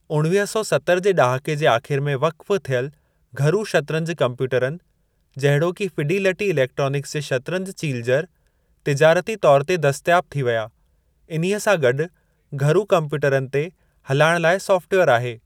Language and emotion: Sindhi, neutral